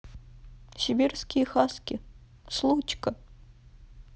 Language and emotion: Russian, sad